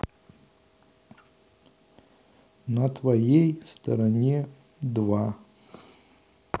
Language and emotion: Russian, neutral